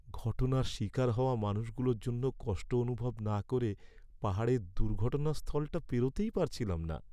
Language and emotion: Bengali, sad